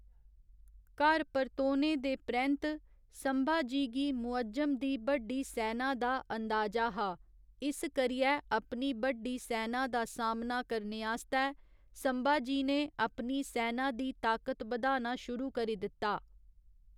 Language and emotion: Dogri, neutral